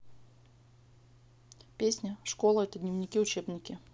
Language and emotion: Russian, neutral